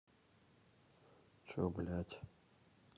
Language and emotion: Russian, neutral